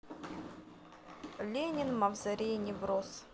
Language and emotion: Russian, neutral